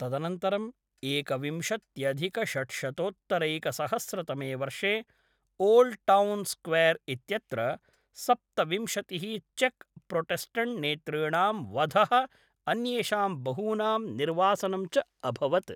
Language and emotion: Sanskrit, neutral